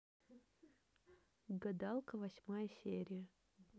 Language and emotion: Russian, neutral